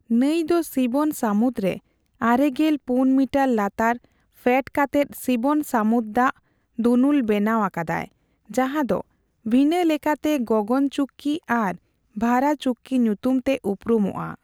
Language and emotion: Santali, neutral